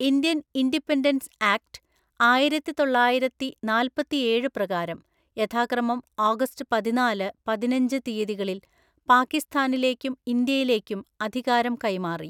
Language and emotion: Malayalam, neutral